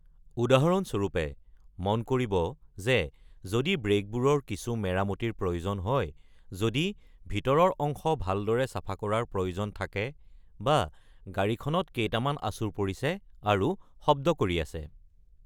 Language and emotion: Assamese, neutral